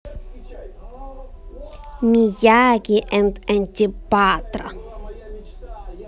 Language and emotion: Russian, positive